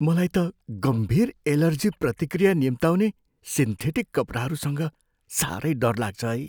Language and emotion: Nepali, fearful